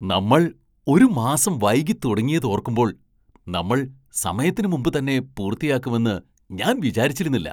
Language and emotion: Malayalam, surprised